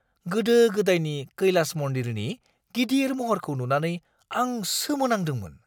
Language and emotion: Bodo, surprised